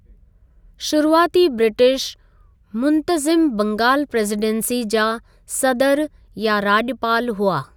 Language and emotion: Sindhi, neutral